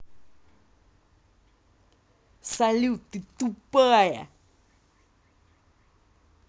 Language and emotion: Russian, angry